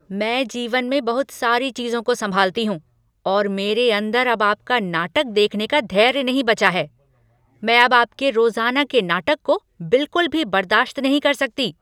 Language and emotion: Hindi, angry